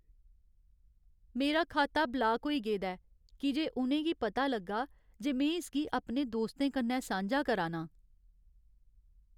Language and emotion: Dogri, sad